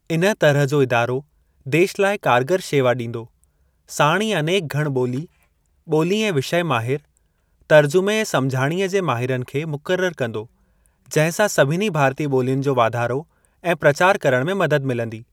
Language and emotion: Sindhi, neutral